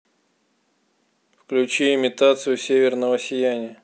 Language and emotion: Russian, neutral